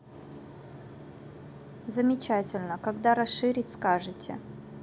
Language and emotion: Russian, neutral